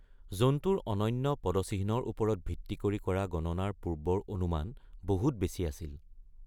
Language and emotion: Assamese, neutral